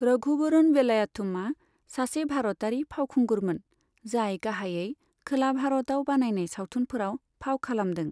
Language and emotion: Bodo, neutral